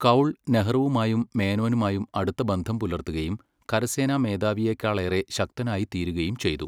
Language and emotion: Malayalam, neutral